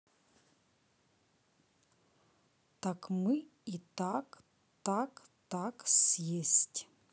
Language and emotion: Russian, neutral